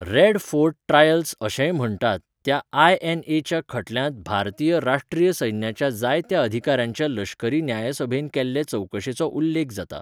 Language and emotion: Goan Konkani, neutral